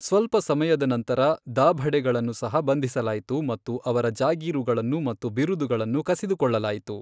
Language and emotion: Kannada, neutral